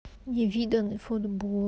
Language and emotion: Russian, sad